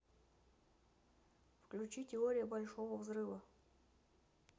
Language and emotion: Russian, neutral